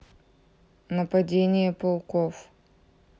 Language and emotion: Russian, neutral